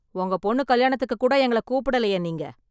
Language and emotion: Tamil, angry